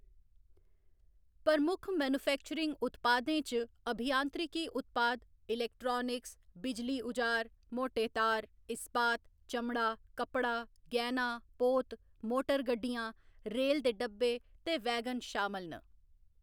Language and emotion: Dogri, neutral